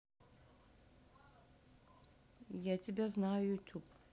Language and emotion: Russian, neutral